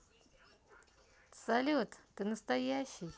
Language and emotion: Russian, positive